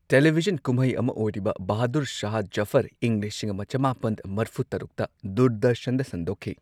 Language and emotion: Manipuri, neutral